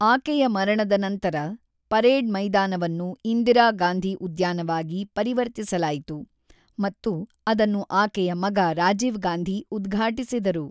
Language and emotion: Kannada, neutral